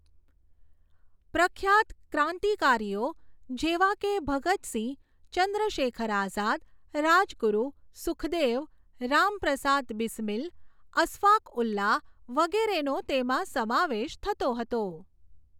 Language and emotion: Gujarati, neutral